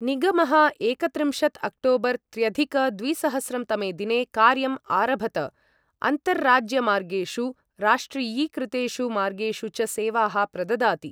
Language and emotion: Sanskrit, neutral